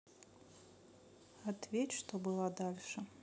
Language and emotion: Russian, neutral